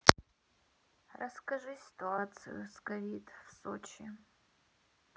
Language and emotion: Russian, sad